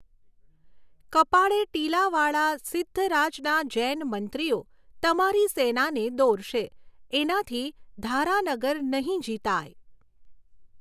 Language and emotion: Gujarati, neutral